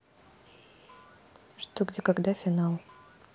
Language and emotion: Russian, neutral